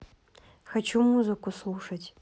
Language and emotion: Russian, neutral